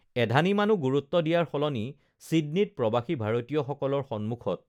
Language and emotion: Assamese, neutral